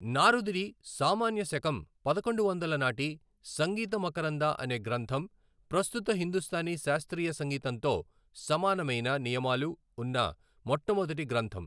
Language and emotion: Telugu, neutral